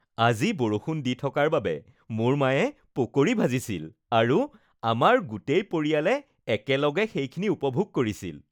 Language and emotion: Assamese, happy